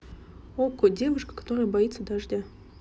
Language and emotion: Russian, neutral